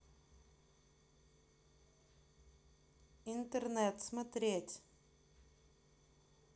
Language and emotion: Russian, neutral